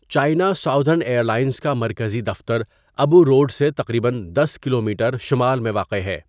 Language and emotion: Urdu, neutral